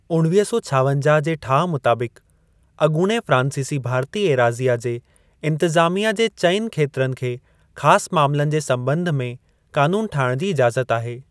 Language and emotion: Sindhi, neutral